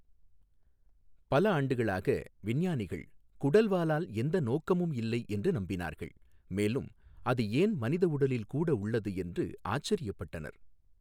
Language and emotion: Tamil, neutral